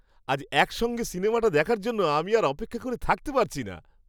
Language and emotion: Bengali, happy